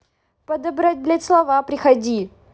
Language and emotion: Russian, angry